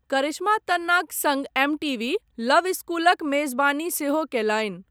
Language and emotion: Maithili, neutral